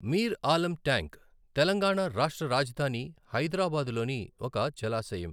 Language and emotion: Telugu, neutral